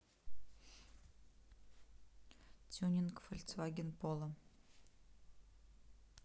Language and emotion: Russian, neutral